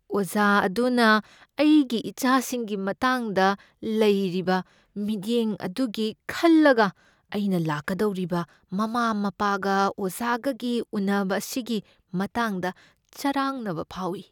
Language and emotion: Manipuri, fearful